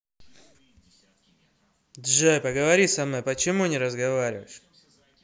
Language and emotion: Russian, angry